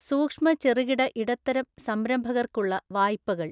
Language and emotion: Malayalam, neutral